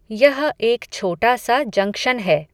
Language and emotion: Hindi, neutral